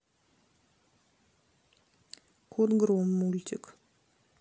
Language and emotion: Russian, neutral